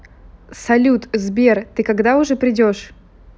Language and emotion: Russian, neutral